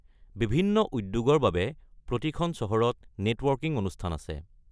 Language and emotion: Assamese, neutral